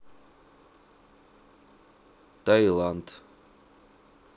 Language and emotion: Russian, neutral